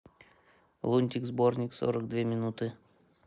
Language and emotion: Russian, neutral